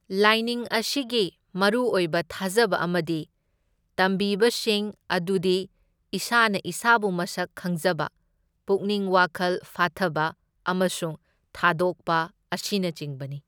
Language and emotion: Manipuri, neutral